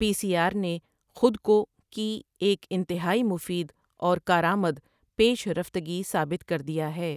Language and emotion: Urdu, neutral